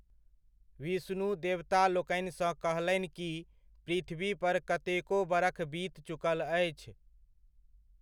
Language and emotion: Maithili, neutral